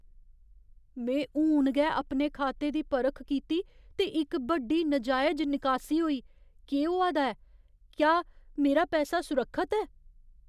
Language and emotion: Dogri, fearful